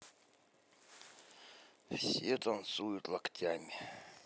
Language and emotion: Russian, neutral